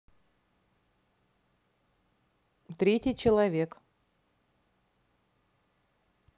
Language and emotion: Russian, neutral